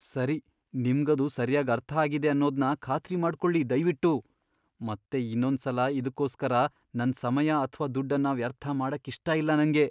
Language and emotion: Kannada, fearful